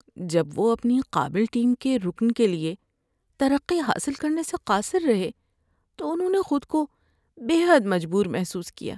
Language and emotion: Urdu, sad